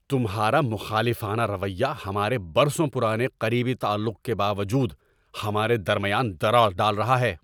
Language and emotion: Urdu, angry